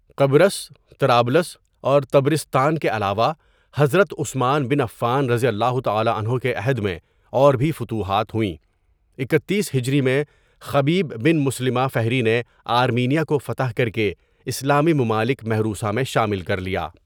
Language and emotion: Urdu, neutral